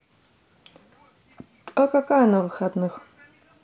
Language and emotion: Russian, neutral